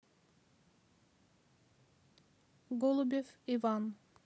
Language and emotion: Russian, neutral